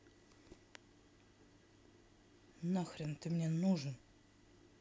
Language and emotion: Russian, angry